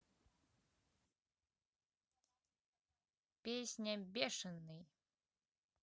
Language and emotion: Russian, neutral